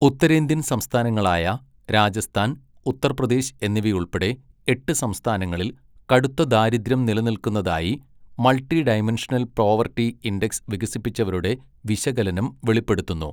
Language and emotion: Malayalam, neutral